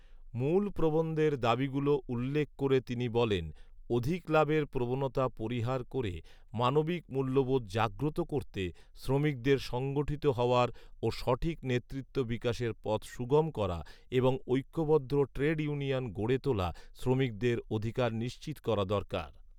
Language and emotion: Bengali, neutral